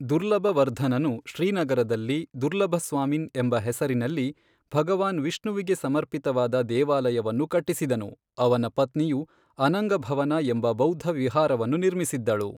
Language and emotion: Kannada, neutral